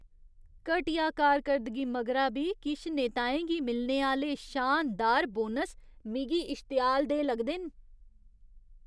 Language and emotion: Dogri, disgusted